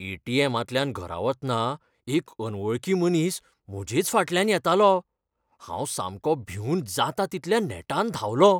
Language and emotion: Goan Konkani, fearful